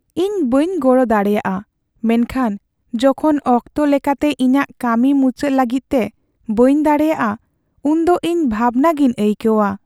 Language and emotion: Santali, sad